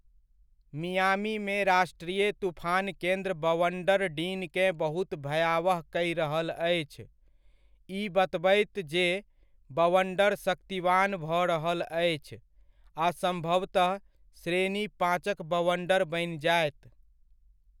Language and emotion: Maithili, neutral